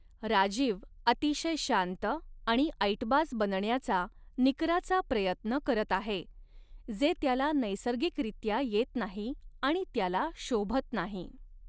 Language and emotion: Marathi, neutral